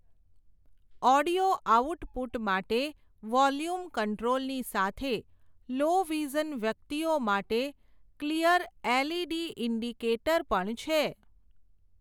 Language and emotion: Gujarati, neutral